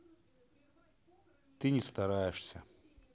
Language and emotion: Russian, sad